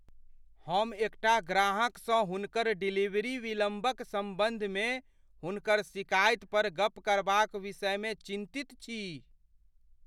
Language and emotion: Maithili, fearful